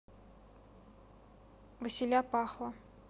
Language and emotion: Russian, neutral